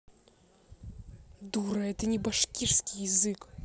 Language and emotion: Russian, angry